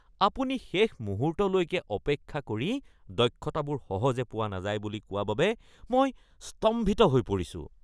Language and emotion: Assamese, disgusted